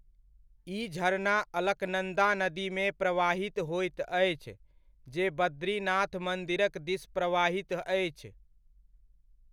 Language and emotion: Maithili, neutral